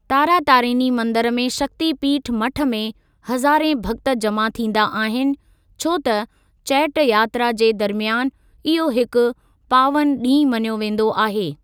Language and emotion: Sindhi, neutral